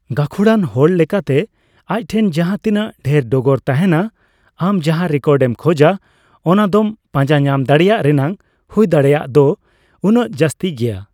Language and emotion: Santali, neutral